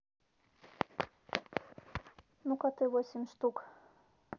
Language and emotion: Russian, neutral